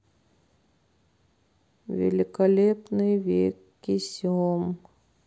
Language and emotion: Russian, sad